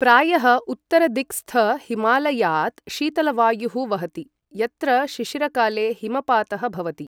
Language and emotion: Sanskrit, neutral